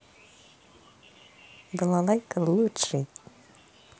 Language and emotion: Russian, neutral